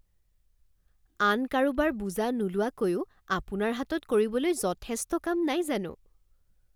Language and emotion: Assamese, surprised